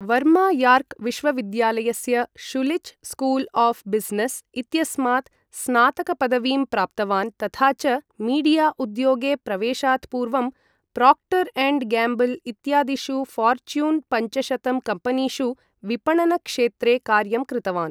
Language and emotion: Sanskrit, neutral